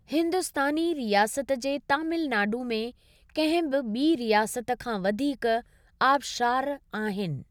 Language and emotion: Sindhi, neutral